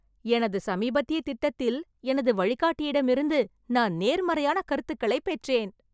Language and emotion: Tamil, happy